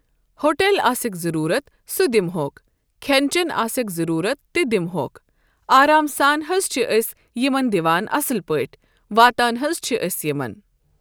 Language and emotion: Kashmiri, neutral